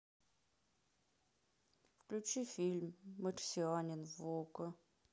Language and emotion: Russian, sad